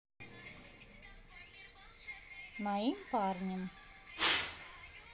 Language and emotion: Russian, neutral